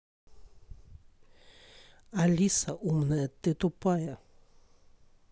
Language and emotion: Russian, angry